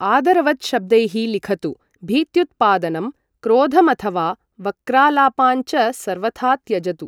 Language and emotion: Sanskrit, neutral